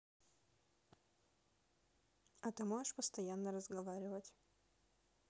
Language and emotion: Russian, neutral